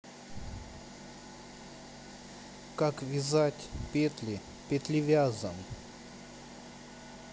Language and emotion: Russian, neutral